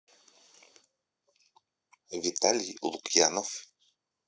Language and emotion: Russian, neutral